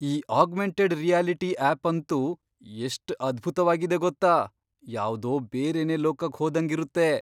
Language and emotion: Kannada, surprised